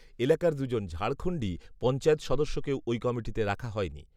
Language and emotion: Bengali, neutral